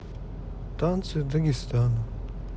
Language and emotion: Russian, sad